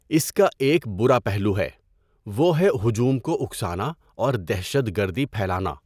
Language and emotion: Urdu, neutral